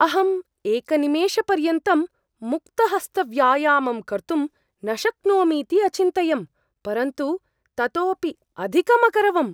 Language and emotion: Sanskrit, surprised